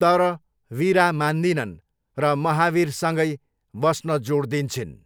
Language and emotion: Nepali, neutral